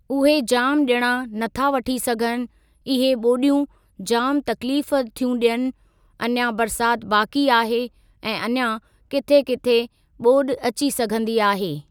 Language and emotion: Sindhi, neutral